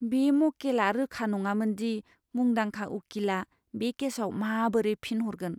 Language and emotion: Bodo, fearful